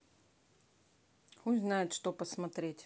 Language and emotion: Russian, neutral